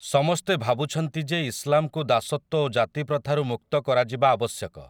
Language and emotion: Odia, neutral